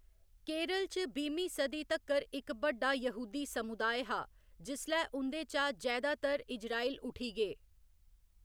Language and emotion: Dogri, neutral